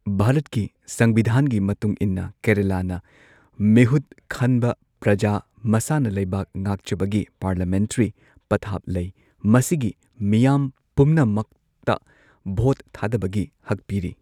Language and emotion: Manipuri, neutral